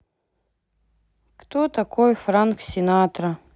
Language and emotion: Russian, sad